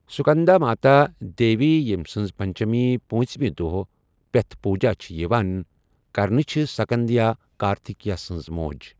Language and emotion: Kashmiri, neutral